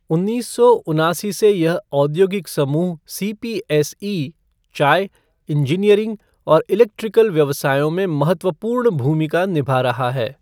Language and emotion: Hindi, neutral